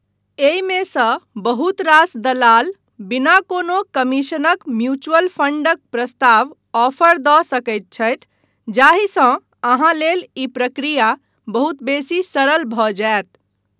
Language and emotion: Maithili, neutral